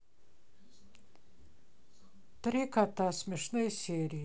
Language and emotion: Russian, neutral